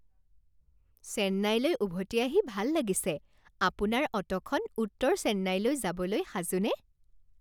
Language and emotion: Assamese, happy